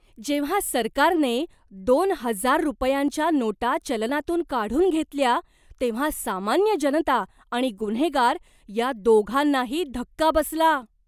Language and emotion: Marathi, surprised